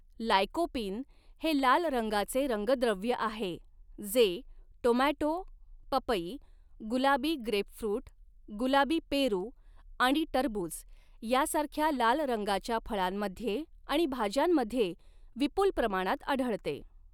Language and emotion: Marathi, neutral